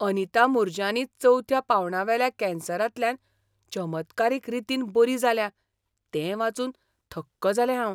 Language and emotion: Goan Konkani, surprised